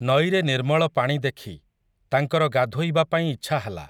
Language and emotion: Odia, neutral